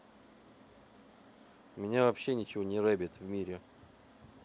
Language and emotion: Russian, neutral